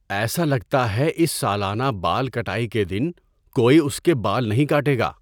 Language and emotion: Urdu, neutral